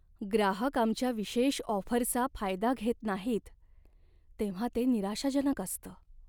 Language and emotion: Marathi, sad